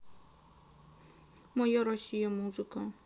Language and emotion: Russian, sad